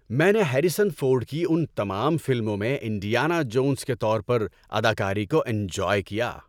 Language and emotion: Urdu, happy